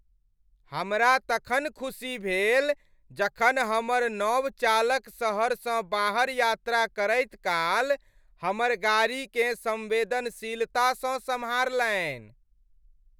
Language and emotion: Maithili, happy